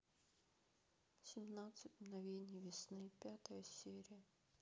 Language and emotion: Russian, sad